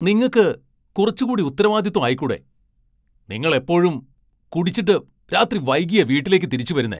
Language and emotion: Malayalam, angry